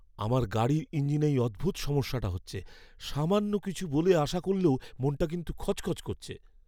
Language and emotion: Bengali, fearful